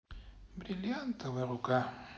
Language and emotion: Russian, sad